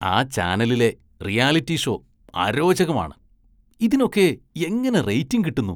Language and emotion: Malayalam, disgusted